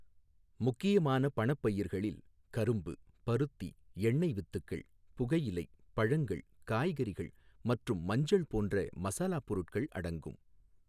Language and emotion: Tamil, neutral